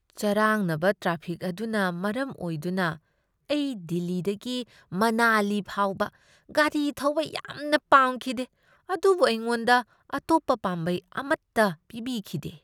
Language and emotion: Manipuri, disgusted